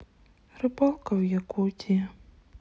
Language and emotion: Russian, sad